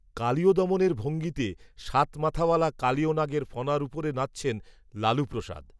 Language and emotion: Bengali, neutral